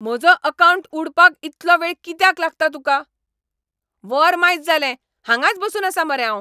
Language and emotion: Goan Konkani, angry